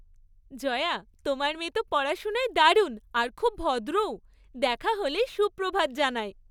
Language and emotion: Bengali, happy